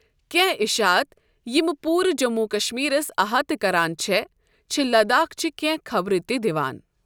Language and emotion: Kashmiri, neutral